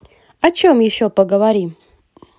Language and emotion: Russian, positive